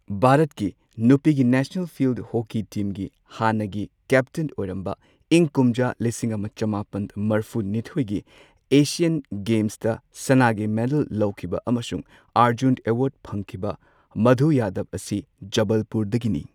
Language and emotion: Manipuri, neutral